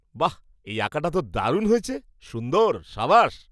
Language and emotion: Bengali, surprised